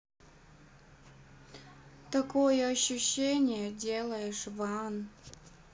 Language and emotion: Russian, sad